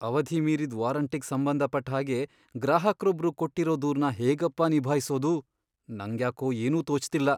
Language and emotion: Kannada, fearful